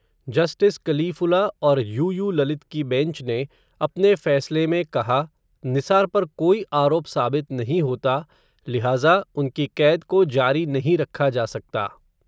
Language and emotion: Hindi, neutral